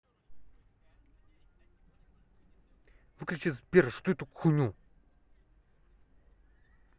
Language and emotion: Russian, angry